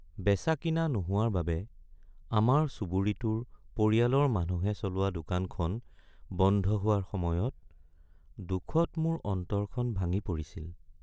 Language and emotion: Assamese, sad